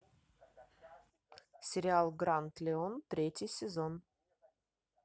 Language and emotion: Russian, neutral